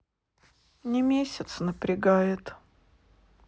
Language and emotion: Russian, sad